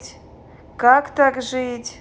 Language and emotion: Russian, sad